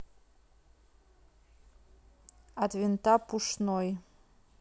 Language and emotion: Russian, neutral